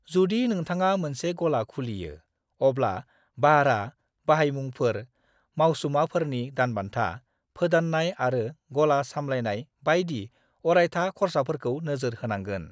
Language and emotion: Bodo, neutral